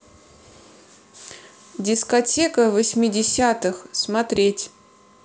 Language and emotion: Russian, neutral